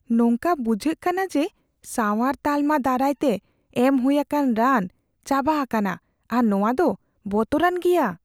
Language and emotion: Santali, fearful